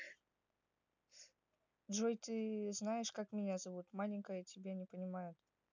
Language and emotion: Russian, neutral